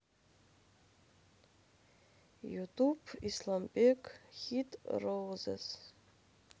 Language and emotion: Russian, sad